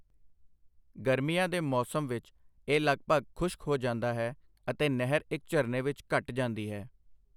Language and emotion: Punjabi, neutral